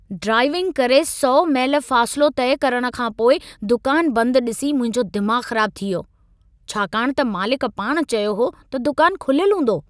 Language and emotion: Sindhi, angry